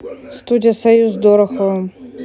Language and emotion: Russian, neutral